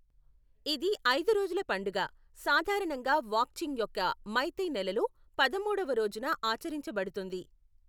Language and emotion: Telugu, neutral